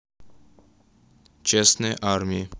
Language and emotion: Russian, neutral